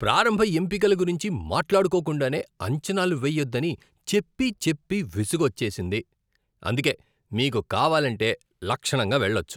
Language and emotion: Telugu, disgusted